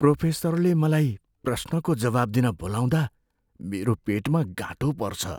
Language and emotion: Nepali, fearful